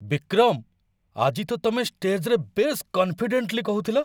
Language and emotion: Odia, surprised